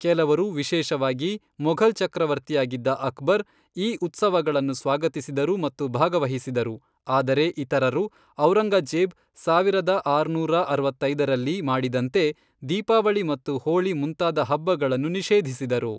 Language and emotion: Kannada, neutral